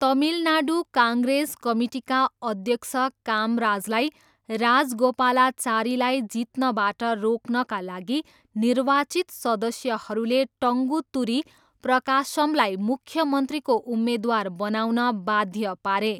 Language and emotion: Nepali, neutral